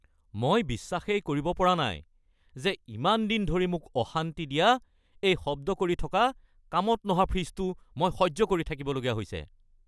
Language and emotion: Assamese, angry